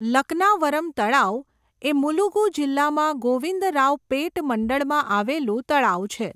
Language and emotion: Gujarati, neutral